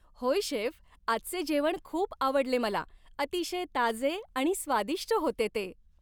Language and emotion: Marathi, happy